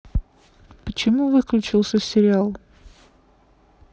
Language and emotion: Russian, neutral